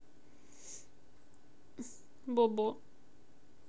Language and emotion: Russian, sad